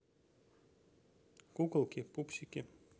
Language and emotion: Russian, neutral